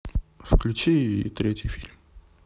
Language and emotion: Russian, neutral